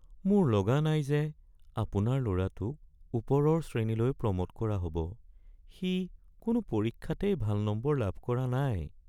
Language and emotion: Assamese, sad